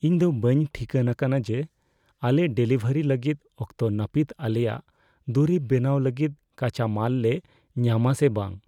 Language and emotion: Santali, fearful